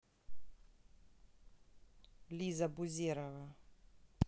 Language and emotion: Russian, neutral